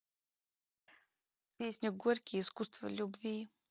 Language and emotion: Russian, neutral